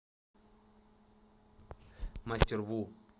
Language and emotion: Russian, neutral